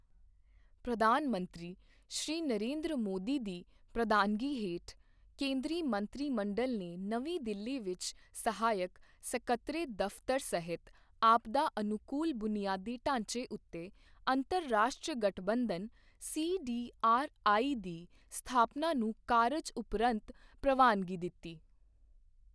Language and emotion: Punjabi, neutral